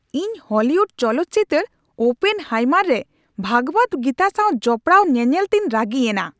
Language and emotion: Santali, angry